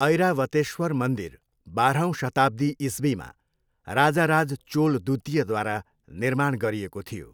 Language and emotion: Nepali, neutral